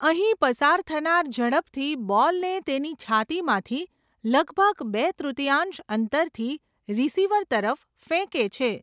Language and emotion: Gujarati, neutral